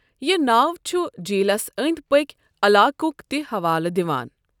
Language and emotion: Kashmiri, neutral